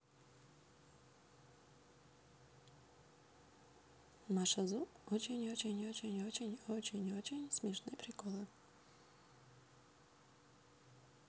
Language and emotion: Russian, neutral